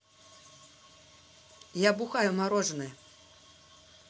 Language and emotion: Russian, neutral